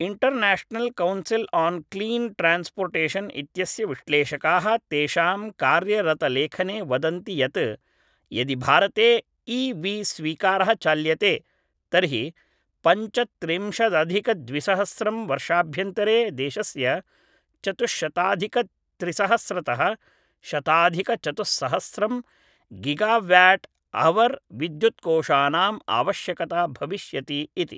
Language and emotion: Sanskrit, neutral